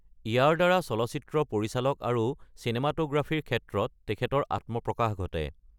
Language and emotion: Assamese, neutral